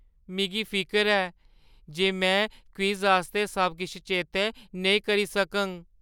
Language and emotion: Dogri, fearful